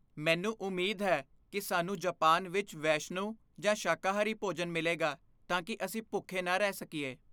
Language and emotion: Punjabi, fearful